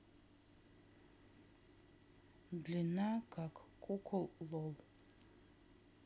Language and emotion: Russian, neutral